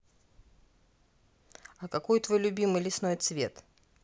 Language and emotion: Russian, neutral